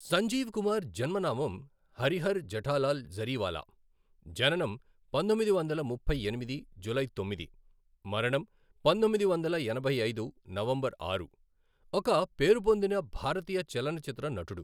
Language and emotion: Telugu, neutral